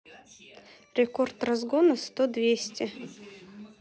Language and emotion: Russian, neutral